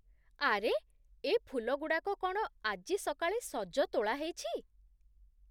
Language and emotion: Odia, surprised